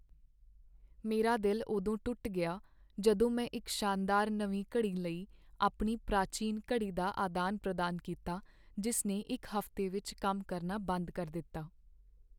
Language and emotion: Punjabi, sad